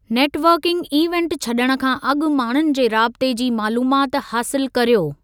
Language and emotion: Sindhi, neutral